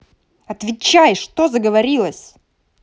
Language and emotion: Russian, angry